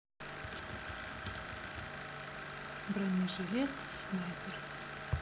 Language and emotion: Russian, neutral